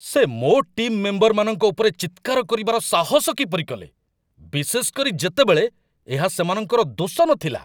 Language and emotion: Odia, angry